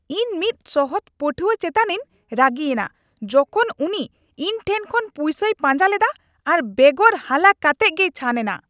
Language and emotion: Santali, angry